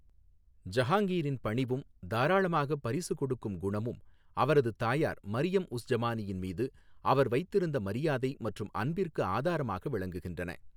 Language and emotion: Tamil, neutral